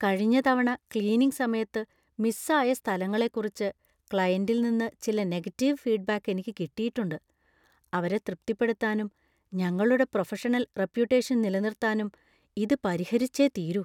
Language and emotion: Malayalam, fearful